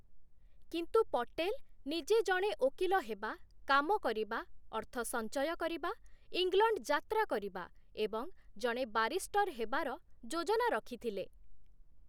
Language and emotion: Odia, neutral